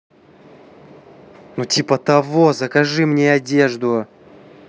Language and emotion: Russian, angry